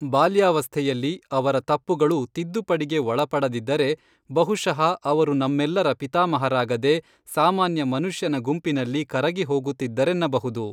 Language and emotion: Kannada, neutral